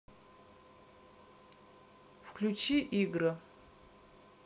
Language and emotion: Russian, neutral